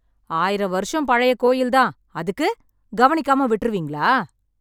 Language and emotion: Tamil, angry